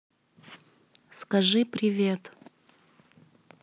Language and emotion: Russian, neutral